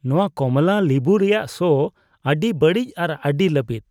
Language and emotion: Santali, disgusted